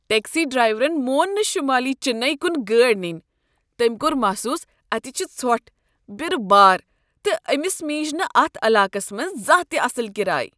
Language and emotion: Kashmiri, disgusted